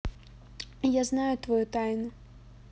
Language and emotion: Russian, neutral